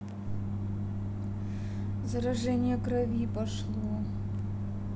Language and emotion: Russian, sad